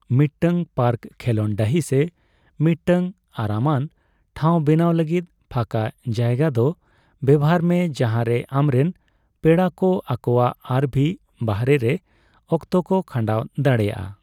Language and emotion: Santali, neutral